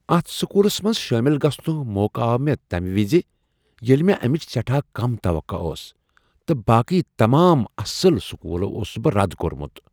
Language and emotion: Kashmiri, surprised